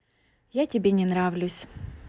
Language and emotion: Russian, sad